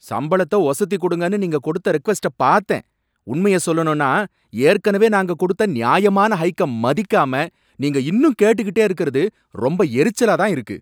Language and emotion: Tamil, angry